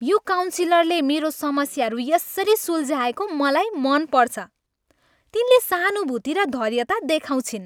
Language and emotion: Nepali, happy